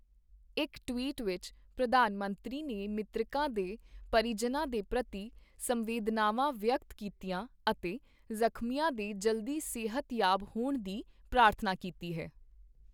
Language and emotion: Punjabi, neutral